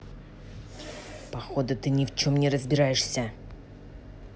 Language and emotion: Russian, angry